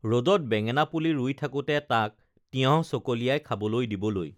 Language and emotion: Assamese, neutral